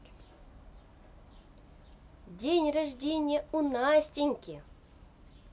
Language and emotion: Russian, positive